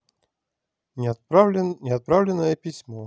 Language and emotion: Russian, neutral